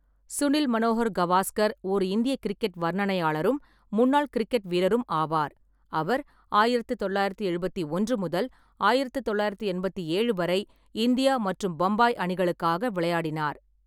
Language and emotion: Tamil, neutral